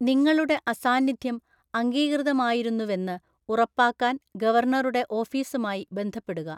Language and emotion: Malayalam, neutral